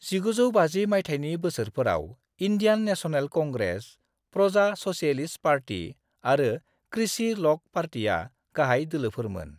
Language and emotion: Bodo, neutral